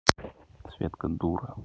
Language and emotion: Russian, neutral